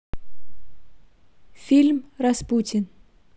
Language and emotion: Russian, neutral